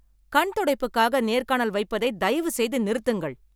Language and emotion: Tamil, angry